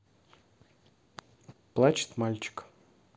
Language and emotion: Russian, neutral